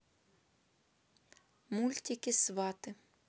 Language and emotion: Russian, neutral